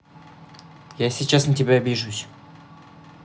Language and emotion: Russian, neutral